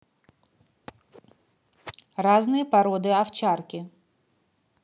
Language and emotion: Russian, neutral